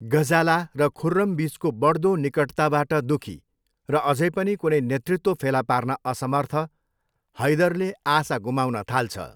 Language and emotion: Nepali, neutral